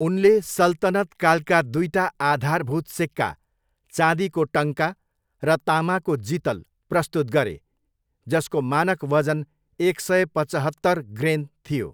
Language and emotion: Nepali, neutral